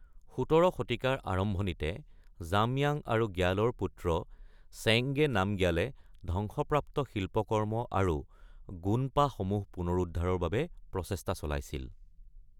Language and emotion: Assamese, neutral